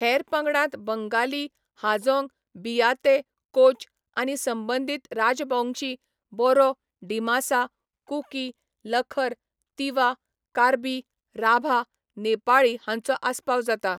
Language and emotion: Goan Konkani, neutral